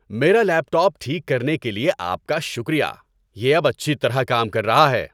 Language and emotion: Urdu, happy